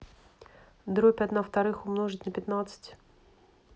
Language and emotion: Russian, neutral